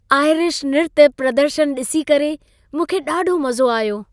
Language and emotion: Sindhi, happy